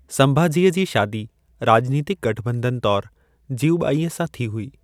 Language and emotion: Sindhi, neutral